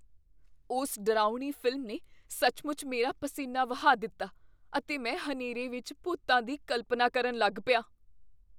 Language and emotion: Punjabi, fearful